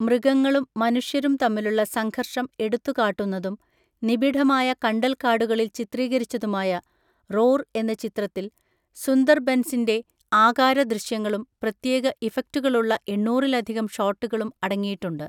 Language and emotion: Malayalam, neutral